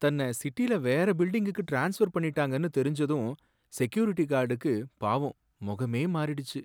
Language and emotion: Tamil, sad